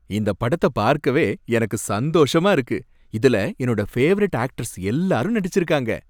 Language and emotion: Tamil, happy